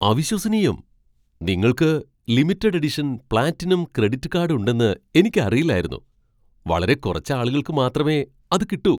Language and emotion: Malayalam, surprised